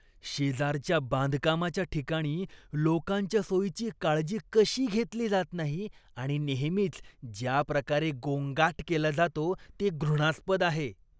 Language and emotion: Marathi, disgusted